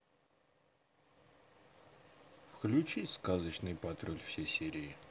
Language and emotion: Russian, neutral